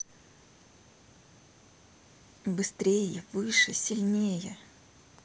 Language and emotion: Russian, neutral